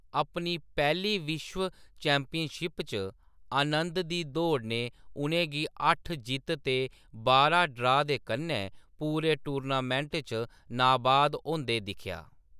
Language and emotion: Dogri, neutral